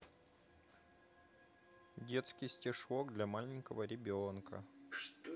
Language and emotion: Russian, neutral